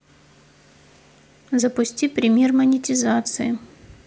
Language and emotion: Russian, neutral